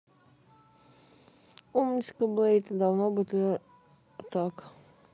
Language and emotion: Russian, neutral